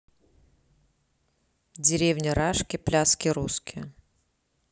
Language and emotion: Russian, neutral